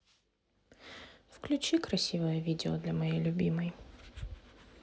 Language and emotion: Russian, sad